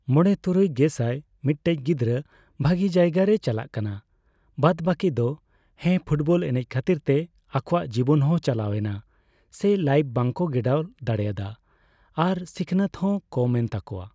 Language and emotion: Santali, neutral